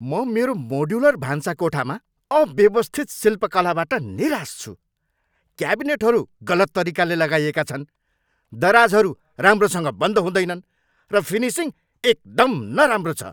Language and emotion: Nepali, angry